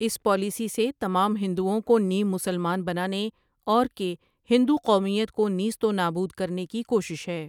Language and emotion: Urdu, neutral